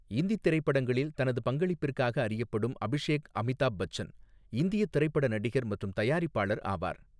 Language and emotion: Tamil, neutral